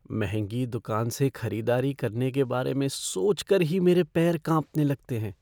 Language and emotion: Hindi, fearful